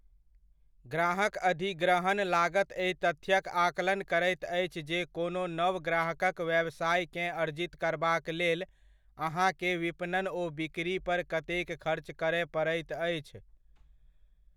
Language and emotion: Maithili, neutral